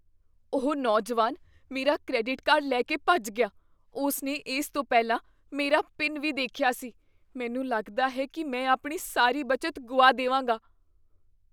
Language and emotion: Punjabi, fearful